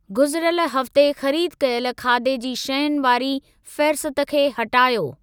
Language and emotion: Sindhi, neutral